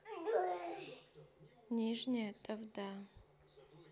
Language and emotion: Russian, neutral